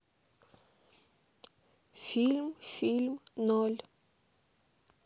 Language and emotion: Russian, neutral